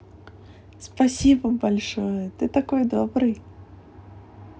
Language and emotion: Russian, positive